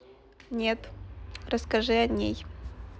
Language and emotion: Russian, neutral